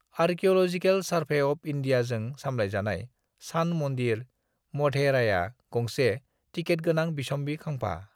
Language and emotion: Bodo, neutral